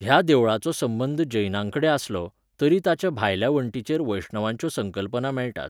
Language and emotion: Goan Konkani, neutral